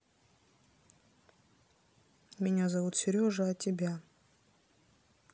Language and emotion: Russian, neutral